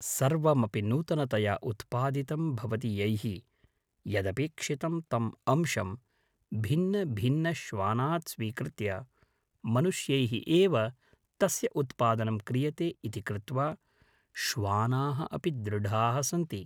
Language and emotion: Sanskrit, neutral